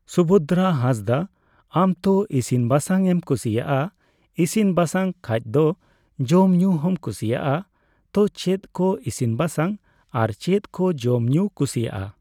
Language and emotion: Santali, neutral